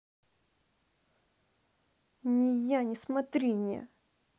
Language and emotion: Russian, angry